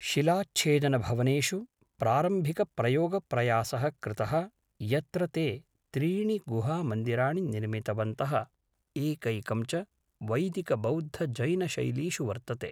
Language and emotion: Sanskrit, neutral